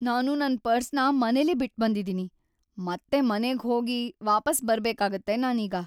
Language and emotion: Kannada, sad